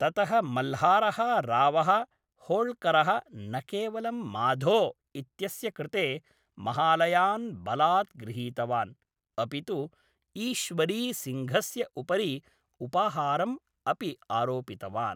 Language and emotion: Sanskrit, neutral